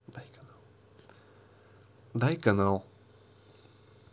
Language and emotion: Russian, neutral